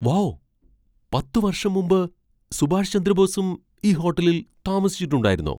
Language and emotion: Malayalam, surprised